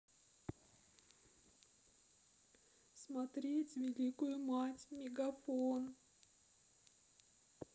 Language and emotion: Russian, sad